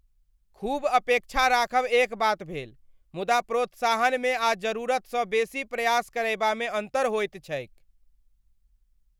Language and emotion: Maithili, angry